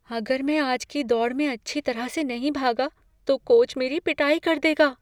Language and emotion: Hindi, fearful